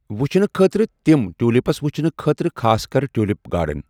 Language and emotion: Kashmiri, neutral